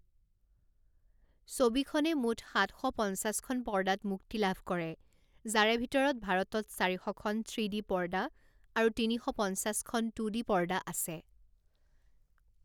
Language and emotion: Assamese, neutral